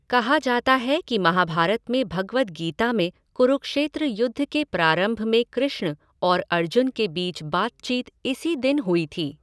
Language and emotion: Hindi, neutral